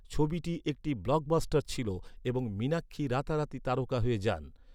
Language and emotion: Bengali, neutral